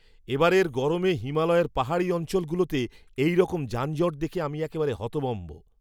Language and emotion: Bengali, surprised